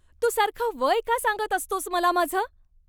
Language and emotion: Marathi, angry